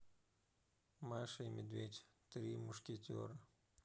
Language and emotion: Russian, neutral